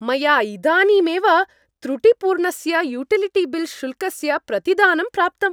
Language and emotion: Sanskrit, happy